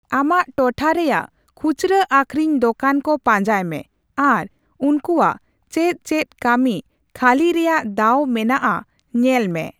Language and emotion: Santali, neutral